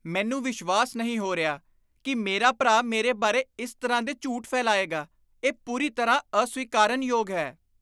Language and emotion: Punjabi, disgusted